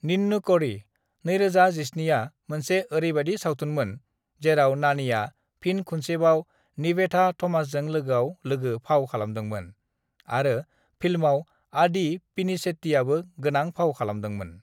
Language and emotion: Bodo, neutral